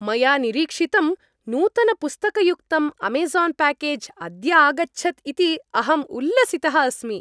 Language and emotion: Sanskrit, happy